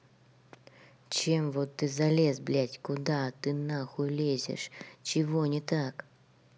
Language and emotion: Russian, angry